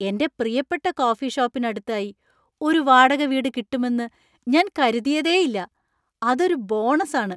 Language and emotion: Malayalam, surprised